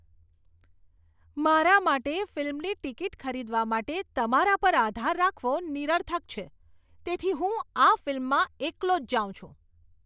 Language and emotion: Gujarati, disgusted